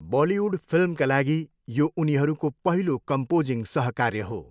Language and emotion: Nepali, neutral